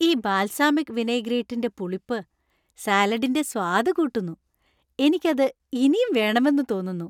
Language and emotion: Malayalam, happy